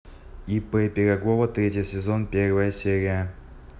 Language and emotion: Russian, neutral